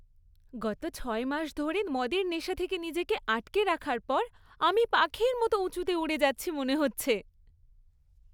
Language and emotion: Bengali, happy